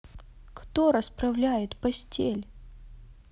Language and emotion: Russian, sad